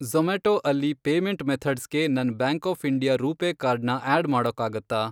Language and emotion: Kannada, neutral